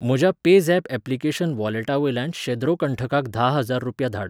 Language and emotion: Goan Konkani, neutral